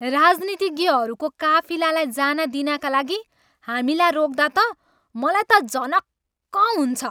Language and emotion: Nepali, angry